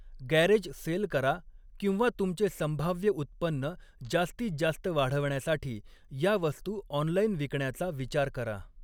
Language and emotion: Marathi, neutral